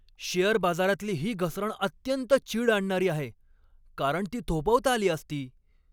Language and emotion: Marathi, angry